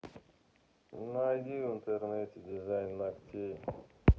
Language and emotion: Russian, neutral